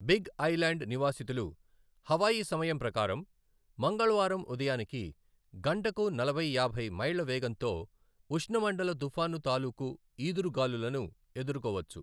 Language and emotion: Telugu, neutral